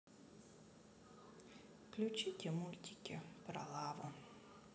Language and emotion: Russian, neutral